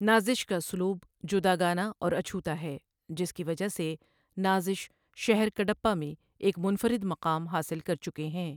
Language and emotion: Urdu, neutral